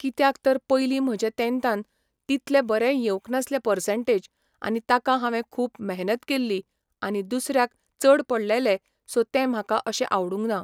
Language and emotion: Goan Konkani, neutral